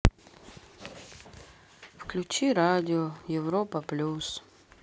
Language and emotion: Russian, sad